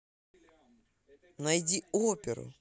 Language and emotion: Russian, positive